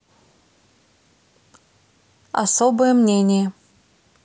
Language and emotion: Russian, neutral